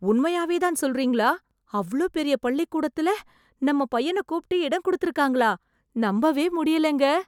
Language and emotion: Tamil, surprised